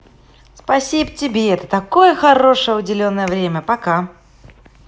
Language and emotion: Russian, positive